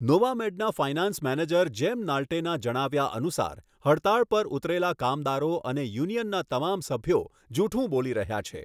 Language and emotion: Gujarati, neutral